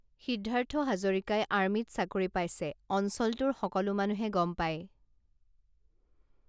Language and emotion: Assamese, neutral